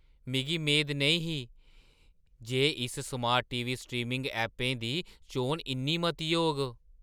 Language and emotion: Dogri, surprised